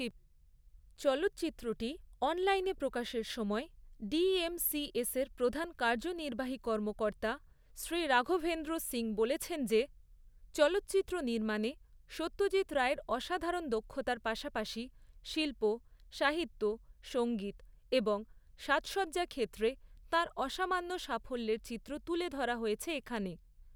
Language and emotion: Bengali, neutral